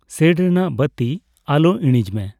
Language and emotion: Santali, neutral